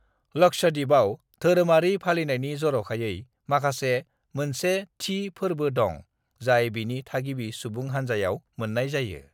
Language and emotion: Bodo, neutral